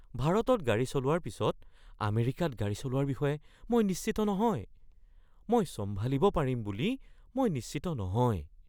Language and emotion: Assamese, fearful